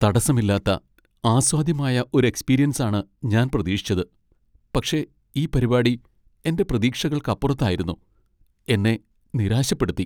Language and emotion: Malayalam, sad